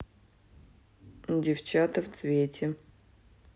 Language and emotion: Russian, neutral